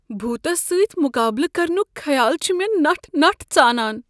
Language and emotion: Kashmiri, fearful